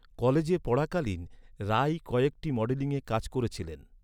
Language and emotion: Bengali, neutral